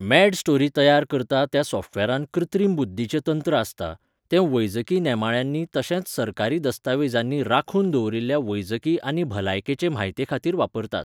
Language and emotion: Goan Konkani, neutral